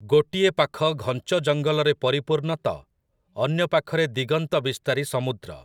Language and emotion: Odia, neutral